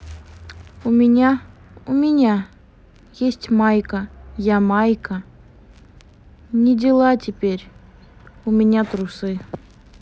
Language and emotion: Russian, sad